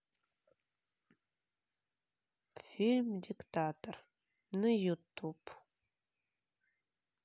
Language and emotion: Russian, sad